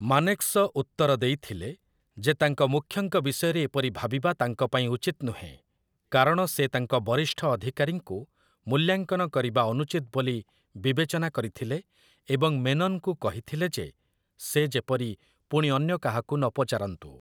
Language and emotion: Odia, neutral